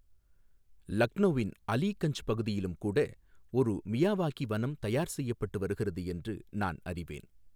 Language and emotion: Tamil, neutral